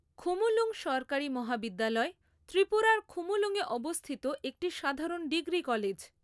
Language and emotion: Bengali, neutral